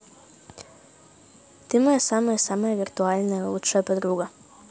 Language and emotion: Russian, positive